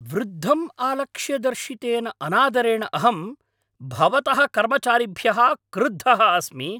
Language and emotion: Sanskrit, angry